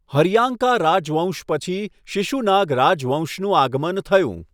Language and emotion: Gujarati, neutral